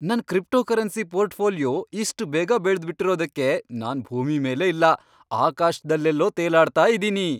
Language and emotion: Kannada, happy